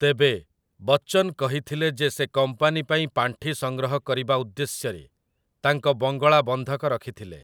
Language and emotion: Odia, neutral